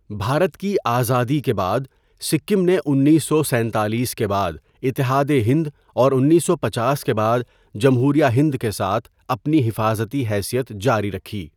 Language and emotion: Urdu, neutral